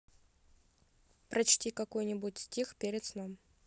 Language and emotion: Russian, neutral